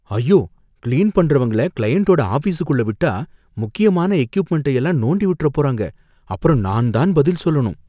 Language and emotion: Tamil, fearful